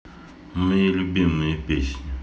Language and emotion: Russian, neutral